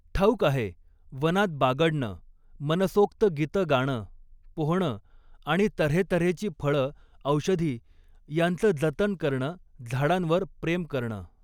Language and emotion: Marathi, neutral